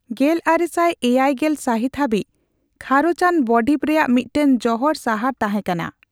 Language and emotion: Santali, neutral